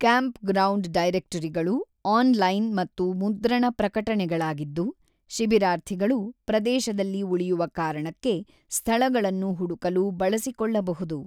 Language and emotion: Kannada, neutral